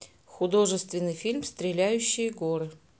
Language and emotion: Russian, neutral